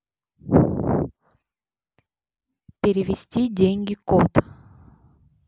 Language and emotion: Russian, neutral